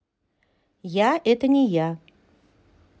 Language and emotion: Russian, neutral